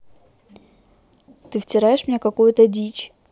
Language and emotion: Russian, angry